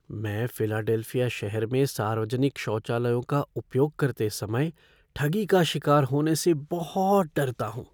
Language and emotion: Hindi, fearful